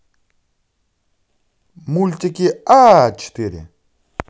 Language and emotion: Russian, positive